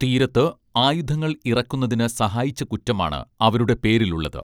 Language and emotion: Malayalam, neutral